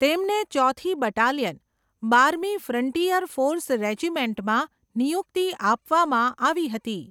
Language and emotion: Gujarati, neutral